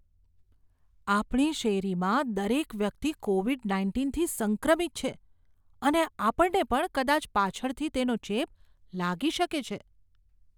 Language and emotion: Gujarati, fearful